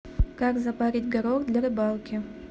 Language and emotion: Russian, neutral